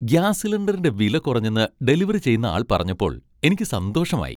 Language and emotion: Malayalam, happy